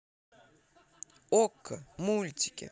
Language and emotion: Russian, positive